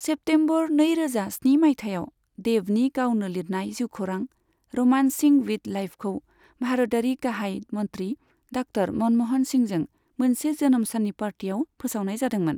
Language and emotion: Bodo, neutral